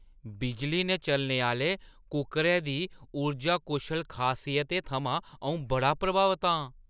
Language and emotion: Dogri, surprised